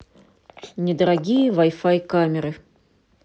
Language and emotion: Russian, neutral